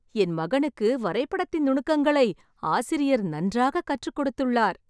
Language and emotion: Tamil, happy